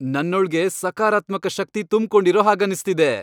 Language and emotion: Kannada, happy